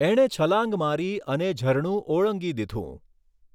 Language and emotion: Gujarati, neutral